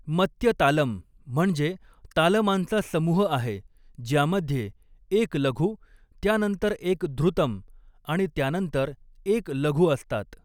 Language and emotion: Marathi, neutral